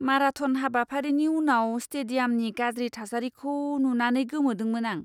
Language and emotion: Bodo, disgusted